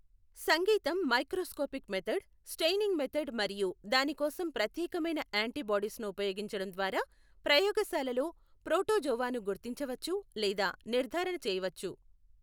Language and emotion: Telugu, neutral